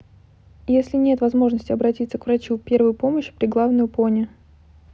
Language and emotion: Russian, neutral